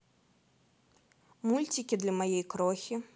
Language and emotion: Russian, positive